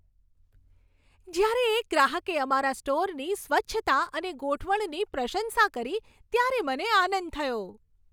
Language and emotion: Gujarati, happy